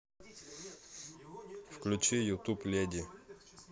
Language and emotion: Russian, neutral